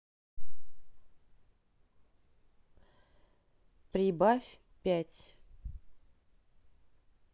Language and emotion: Russian, neutral